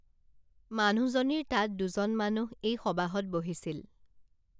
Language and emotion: Assamese, neutral